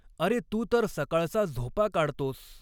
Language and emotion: Marathi, neutral